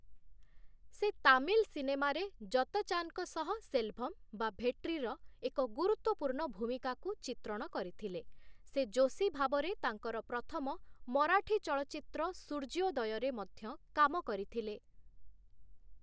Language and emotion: Odia, neutral